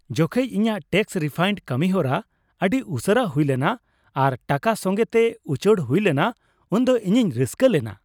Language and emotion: Santali, happy